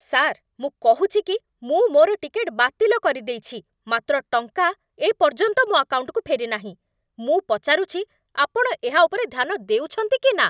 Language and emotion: Odia, angry